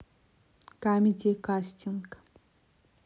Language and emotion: Russian, neutral